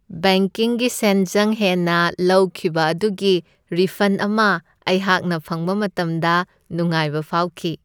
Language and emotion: Manipuri, happy